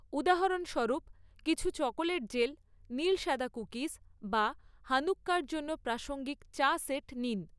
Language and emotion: Bengali, neutral